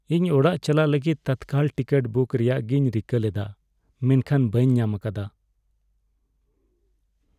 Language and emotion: Santali, sad